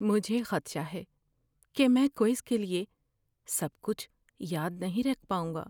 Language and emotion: Urdu, fearful